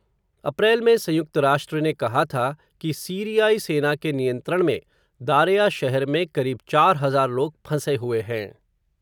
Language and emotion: Hindi, neutral